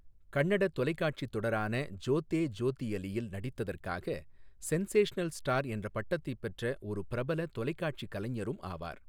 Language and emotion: Tamil, neutral